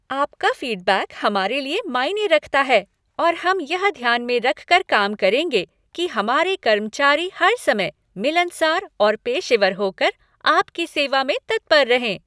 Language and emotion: Hindi, happy